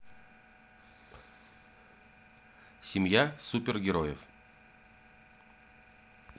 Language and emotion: Russian, neutral